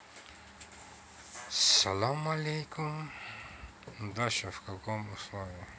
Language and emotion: Russian, neutral